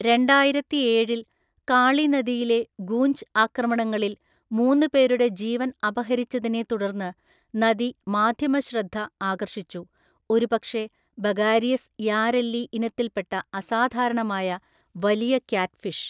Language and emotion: Malayalam, neutral